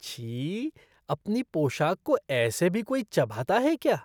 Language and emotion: Hindi, disgusted